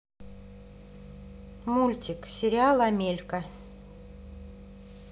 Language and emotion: Russian, neutral